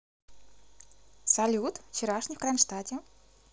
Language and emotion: Russian, positive